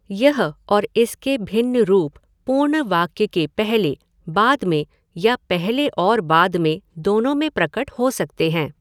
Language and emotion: Hindi, neutral